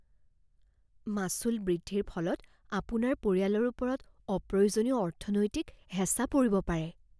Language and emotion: Assamese, fearful